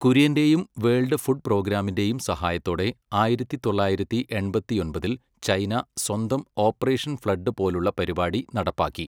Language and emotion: Malayalam, neutral